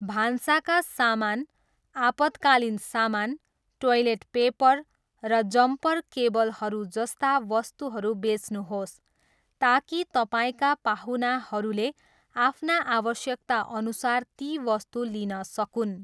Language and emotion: Nepali, neutral